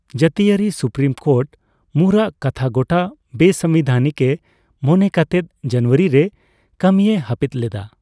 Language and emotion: Santali, neutral